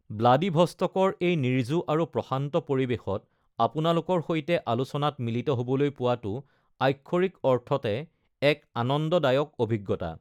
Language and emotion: Assamese, neutral